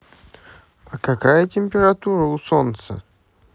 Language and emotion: Russian, positive